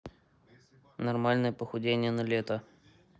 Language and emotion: Russian, neutral